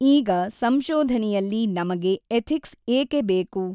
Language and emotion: Kannada, neutral